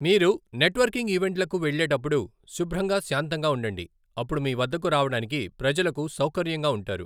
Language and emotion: Telugu, neutral